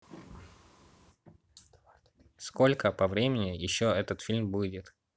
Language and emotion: Russian, neutral